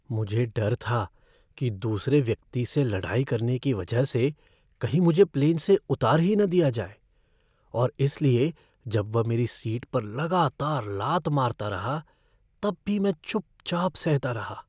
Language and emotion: Hindi, fearful